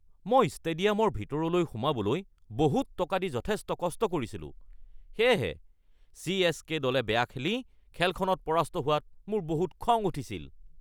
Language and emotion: Assamese, angry